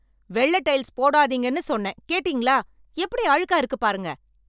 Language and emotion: Tamil, angry